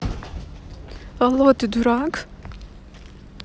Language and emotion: Russian, neutral